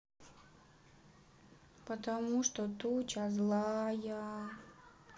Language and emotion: Russian, sad